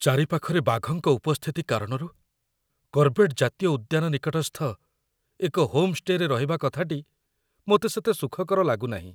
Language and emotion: Odia, fearful